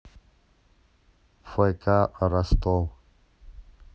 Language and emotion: Russian, neutral